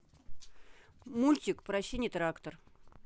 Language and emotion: Russian, neutral